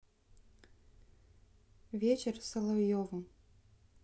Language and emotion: Russian, neutral